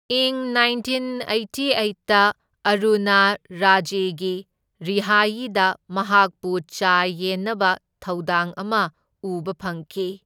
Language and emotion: Manipuri, neutral